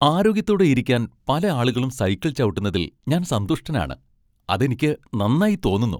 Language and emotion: Malayalam, happy